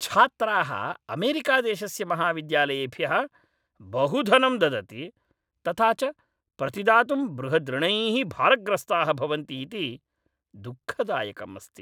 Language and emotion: Sanskrit, angry